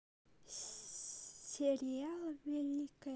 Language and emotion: Russian, neutral